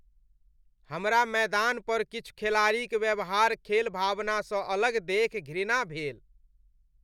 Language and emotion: Maithili, disgusted